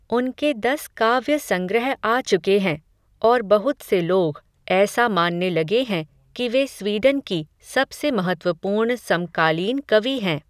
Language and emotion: Hindi, neutral